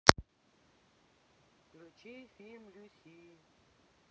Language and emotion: Russian, neutral